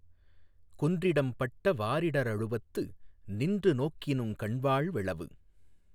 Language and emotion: Tamil, neutral